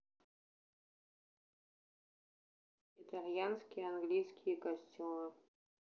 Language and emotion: Russian, neutral